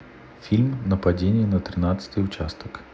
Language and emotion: Russian, neutral